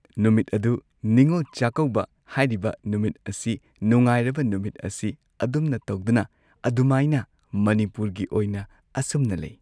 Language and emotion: Manipuri, neutral